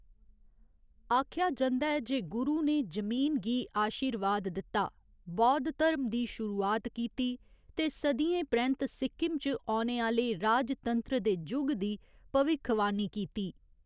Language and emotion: Dogri, neutral